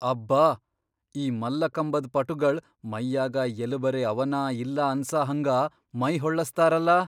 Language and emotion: Kannada, surprised